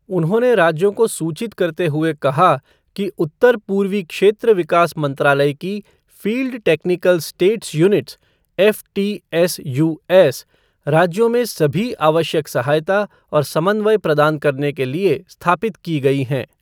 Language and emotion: Hindi, neutral